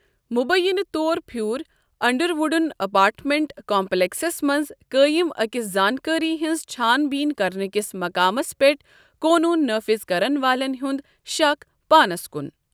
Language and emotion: Kashmiri, neutral